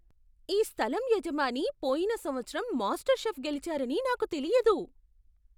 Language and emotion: Telugu, surprised